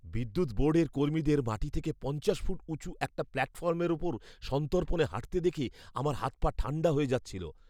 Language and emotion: Bengali, fearful